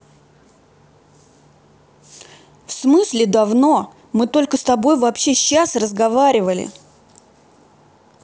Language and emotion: Russian, angry